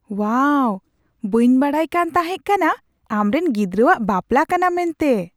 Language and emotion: Santali, surprised